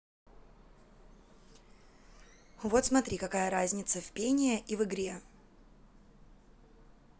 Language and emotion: Russian, neutral